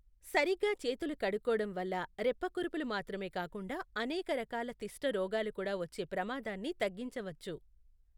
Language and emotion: Telugu, neutral